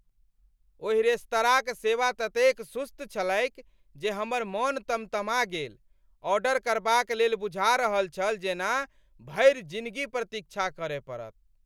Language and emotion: Maithili, angry